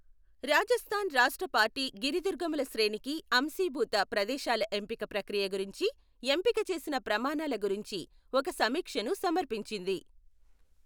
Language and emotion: Telugu, neutral